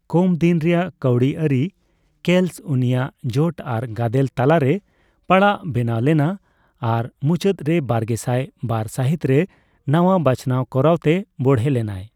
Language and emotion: Santali, neutral